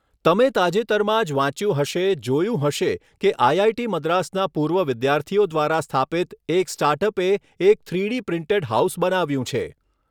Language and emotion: Gujarati, neutral